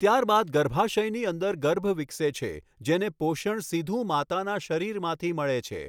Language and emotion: Gujarati, neutral